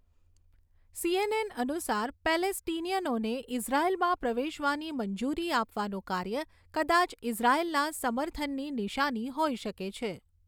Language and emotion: Gujarati, neutral